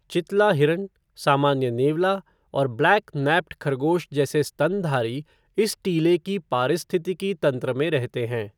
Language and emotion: Hindi, neutral